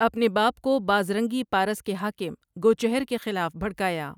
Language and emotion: Urdu, neutral